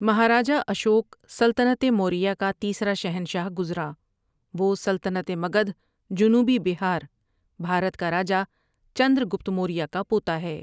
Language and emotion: Urdu, neutral